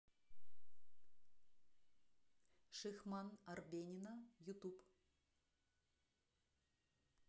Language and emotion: Russian, neutral